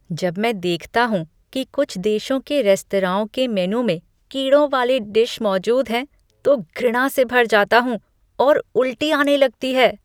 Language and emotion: Hindi, disgusted